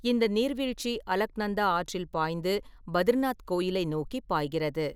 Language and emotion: Tamil, neutral